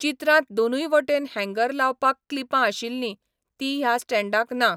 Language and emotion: Goan Konkani, neutral